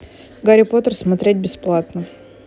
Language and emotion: Russian, neutral